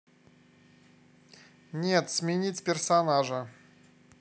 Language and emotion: Russian, neutral